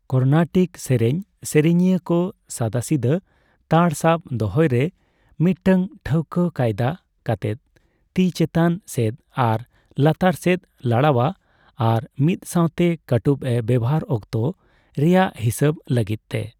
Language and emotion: Santali, neutral